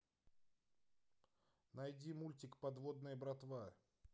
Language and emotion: Russian, neutral